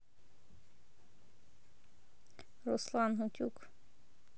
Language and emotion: Russian, neutral